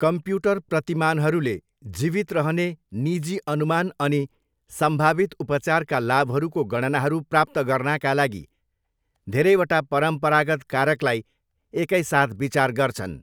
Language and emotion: Nepali, neutral